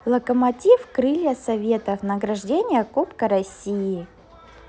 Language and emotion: Russian, positive